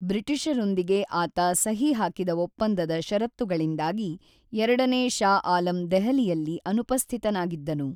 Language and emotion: Kannada, neutral